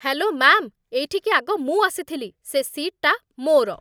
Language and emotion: Odia, angry